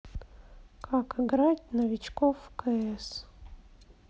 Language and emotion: Russian, sad